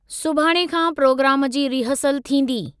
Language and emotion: Sindhi, neutral